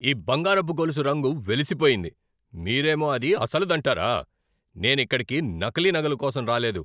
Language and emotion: Telugu, angry